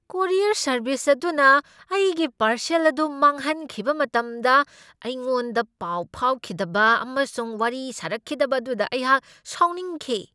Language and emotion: Manipuri, angry